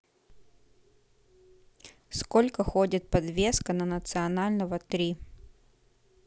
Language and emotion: Russian, neutral